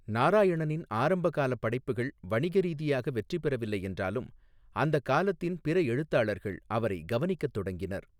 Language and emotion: Tamil, neutral